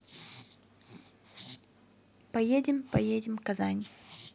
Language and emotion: Russian, neutral